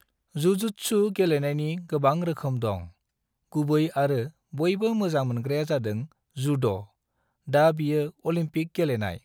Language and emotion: Bodo, neutral